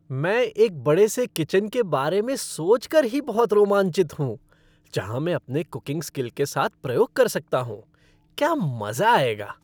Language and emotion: Hindi, happy